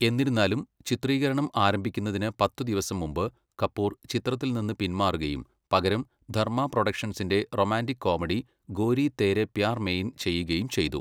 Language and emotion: Malayalam, neutral